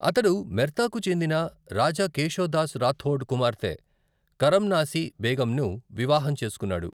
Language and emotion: Telugu, neutral